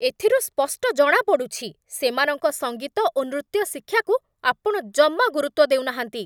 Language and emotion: Odia, angry